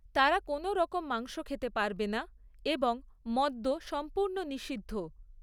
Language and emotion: Bengali, neutral